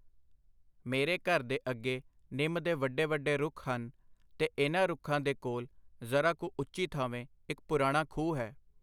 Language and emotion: Punjabi, neutral